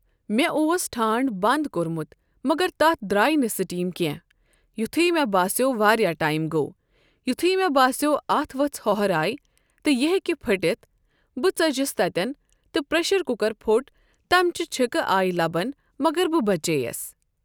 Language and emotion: Kashmiri, neutral